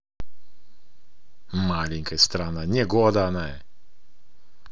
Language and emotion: Russian, angry